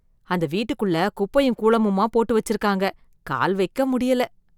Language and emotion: Tamil, disgusted